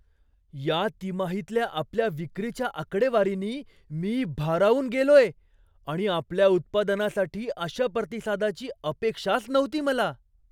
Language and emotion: Marathi, surprised